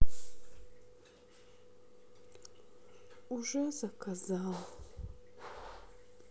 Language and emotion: Russian, sad